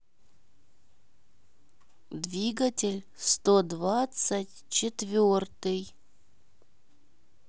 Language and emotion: Russian, neutral